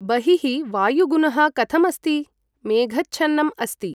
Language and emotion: Sanskrit, neutral